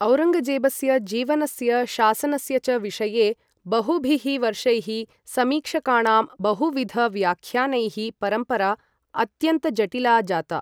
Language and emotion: Sanskrit, neutral